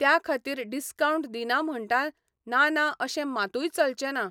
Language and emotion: Goan Konkani, neutral